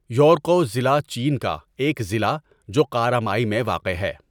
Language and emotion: Urdu, neutral